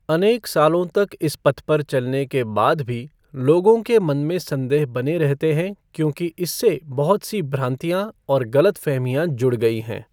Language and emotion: Hindi, neutral